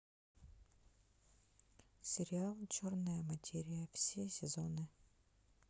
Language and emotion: Russian, sad